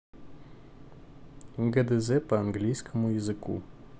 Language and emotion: Russian, neutral